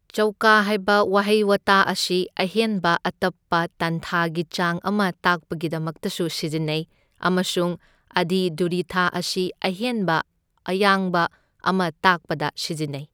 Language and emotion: Manipuri, neutral